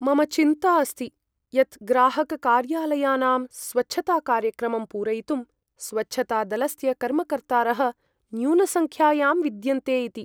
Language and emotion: Sanskrit, fearful